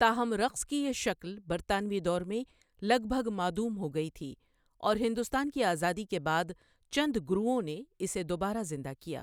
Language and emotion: Urdu, neutral